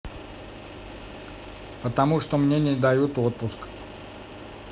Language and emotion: Russian, neutral